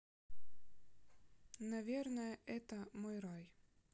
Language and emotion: Russian, neutral